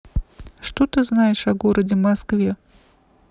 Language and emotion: Russian, neutral